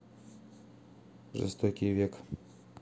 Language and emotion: Russian, neutral